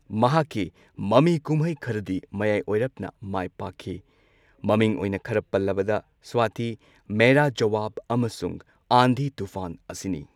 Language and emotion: Manipuri, neutral